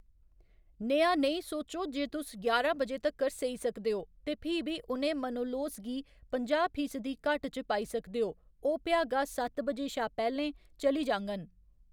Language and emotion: Dogri, neutral